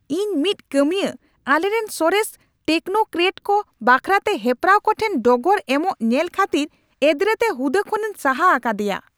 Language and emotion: Santali, angry